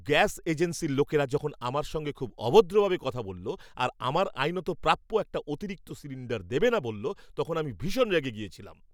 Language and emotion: Bengali, angry